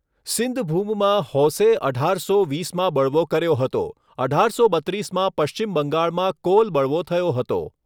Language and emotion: Gujarati, neutral